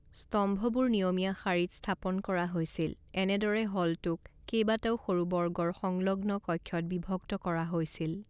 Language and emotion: Assamese, neutral